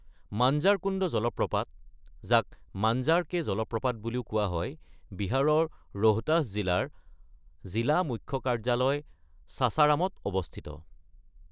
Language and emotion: Assamese, neutral